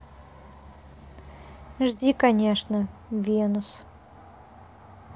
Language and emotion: Russian, neutral